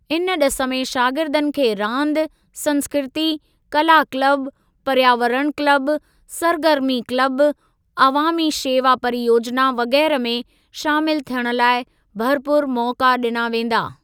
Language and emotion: Sindhi, neutral